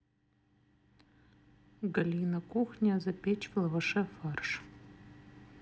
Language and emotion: Russian, neutral